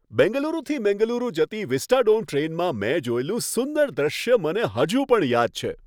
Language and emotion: Gujarati, happy